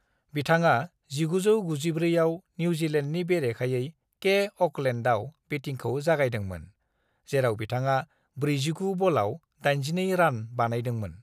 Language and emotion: Bodo, neutral